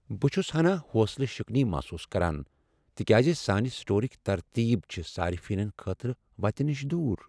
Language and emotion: Kashmiri, sad